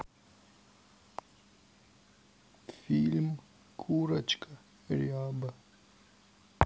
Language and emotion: Russian, sad